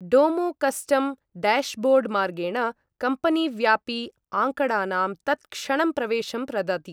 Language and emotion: Sanskrit, neutral